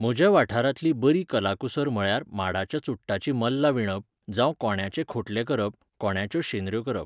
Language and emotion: Goan Konkani, neutral